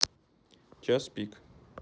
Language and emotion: Russian, neutral